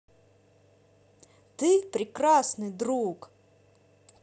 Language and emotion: Russian, positive